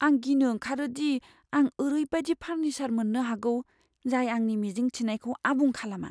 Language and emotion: Bodo, fearful